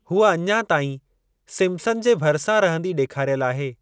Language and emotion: Sindhi, neutral